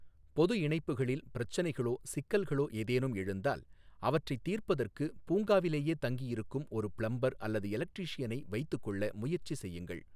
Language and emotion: Tamil, neutral